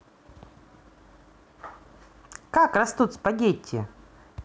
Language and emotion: Russian, positive